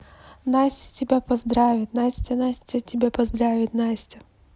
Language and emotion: Russian, neutral